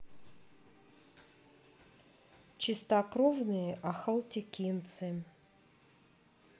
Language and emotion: Russian, neutral